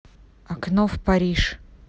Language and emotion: Russian, neutral